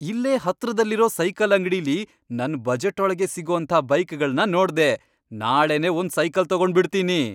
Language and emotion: Kannada, happy